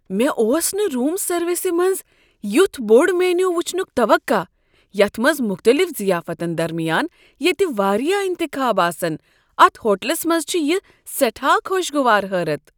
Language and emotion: Kashmiri, surprised